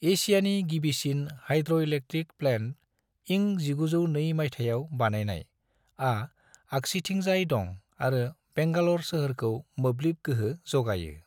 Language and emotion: Bodo, neutral